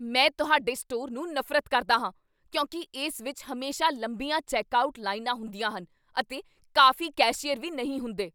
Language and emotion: Punjabi, angry